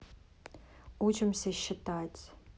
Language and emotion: Russian, neutral